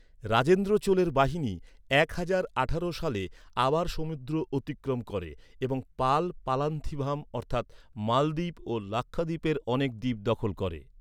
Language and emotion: Bengali, neutral